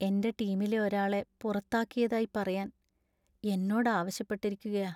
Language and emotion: Malayalam, sad